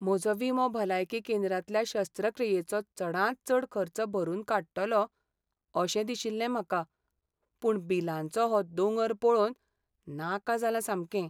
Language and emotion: Goan Konkani, sad